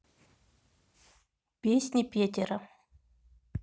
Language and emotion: Russian, neutral